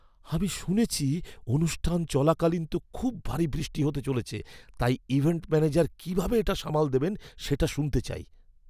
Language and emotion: Bengali, fearful